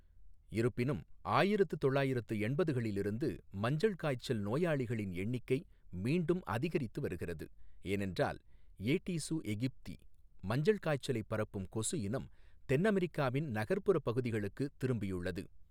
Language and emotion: Tamil, neutral